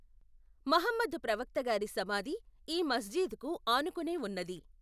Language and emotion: Telugu, neutral